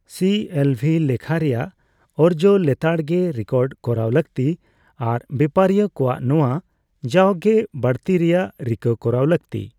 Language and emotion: Santali, neutral